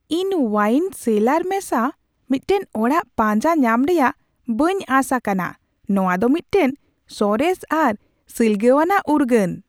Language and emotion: Santali, surprised